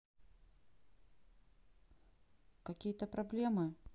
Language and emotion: Russian, neutral